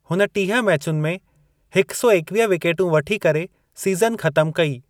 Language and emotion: Sindhi, neutral